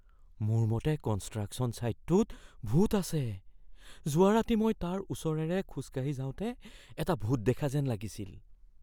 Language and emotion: Assamese, fearful